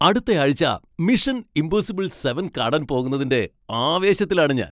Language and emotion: Malayalam, happy